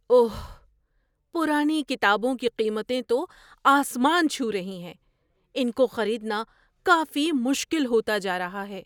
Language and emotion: Urdu, surprised